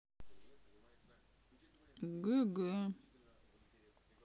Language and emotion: Russian, sad